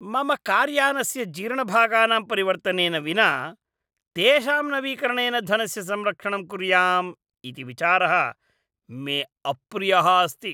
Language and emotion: Sanskrit, disgusted